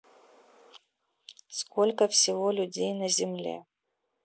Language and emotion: Russian, neutral